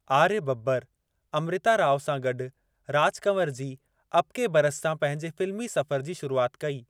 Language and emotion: Sindhi, neutral